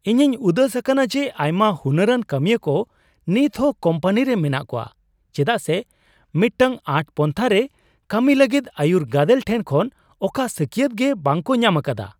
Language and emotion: Santali, surprised